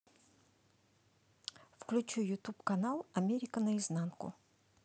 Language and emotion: Russian, neutral